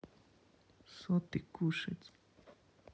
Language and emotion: Russian, neutral